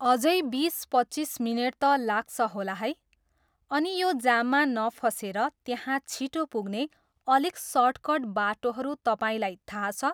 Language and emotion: Nepali, neutral